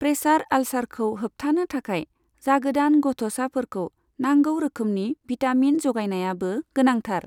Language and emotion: Bodo, neutral